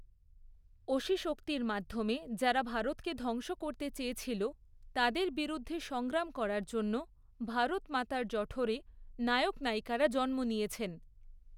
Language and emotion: Bengali, neutral